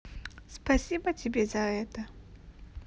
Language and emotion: Russian, neutral